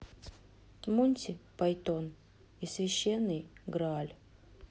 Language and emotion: Russian, neutral